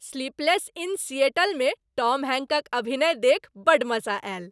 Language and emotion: Maithili, happy